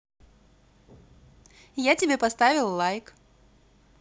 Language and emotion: Russian, positive